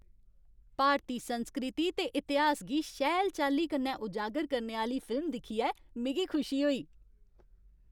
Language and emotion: Dogri, happy